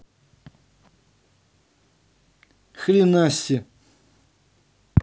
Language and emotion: Russian, neutral